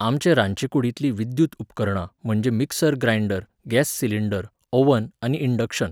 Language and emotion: Goan Konkani, neutral